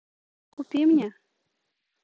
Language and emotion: Russian, neutral